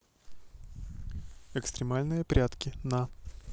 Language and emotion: Russian, neutral